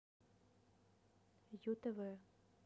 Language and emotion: Russian, neutral